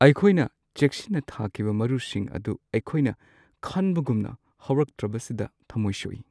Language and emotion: Manipuri, sad